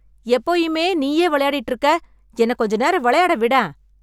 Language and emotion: Tamil, angry